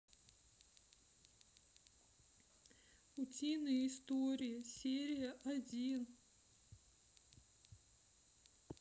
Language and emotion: Russian, sad